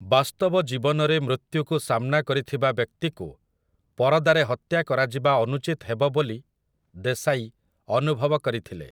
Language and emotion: Odia, neutral